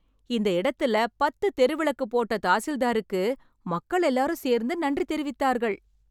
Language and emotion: Tamil, happy